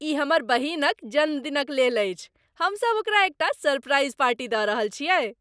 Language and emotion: Maithili, happy